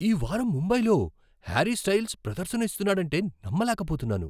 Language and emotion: Telugu, surprised